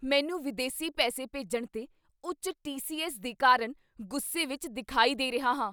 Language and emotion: Punjabi, angry